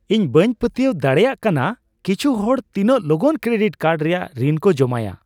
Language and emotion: Santali, surprised